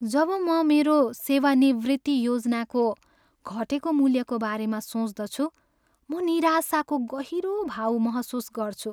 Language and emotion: Nepali, sad